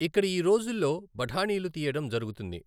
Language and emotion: Telugu, neutral